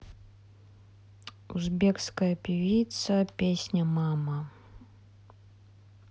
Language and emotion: Russian, neutral